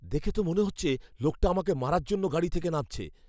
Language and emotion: Bengali, fearful